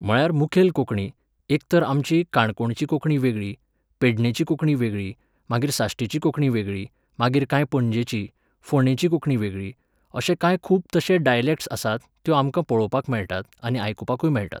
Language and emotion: Goan Konkani, neutral